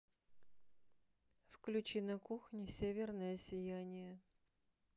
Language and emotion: Russian, neutral